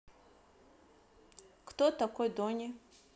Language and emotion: Russian, neutral